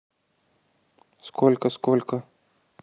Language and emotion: Russian, neutral